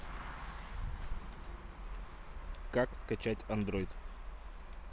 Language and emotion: Russian, neutral